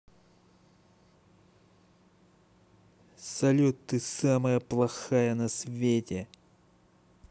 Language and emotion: Russian, angry